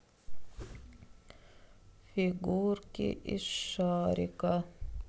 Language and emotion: Russian, sad